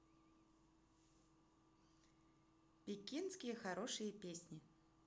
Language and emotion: Russian, positive